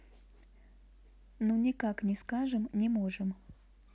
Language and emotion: Russian, neutral